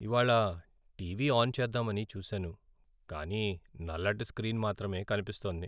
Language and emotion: Telugu, sad